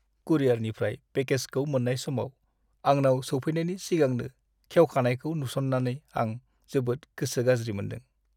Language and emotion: Bodo, sad